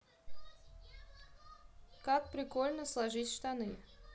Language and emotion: Russian, neutral